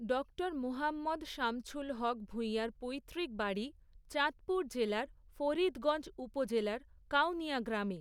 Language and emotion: Bengali, neutral